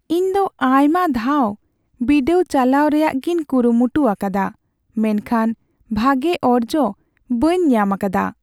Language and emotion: Santali, sad